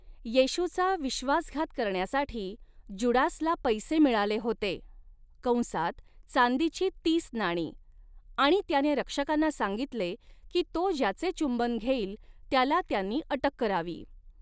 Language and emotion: Marathi, neutral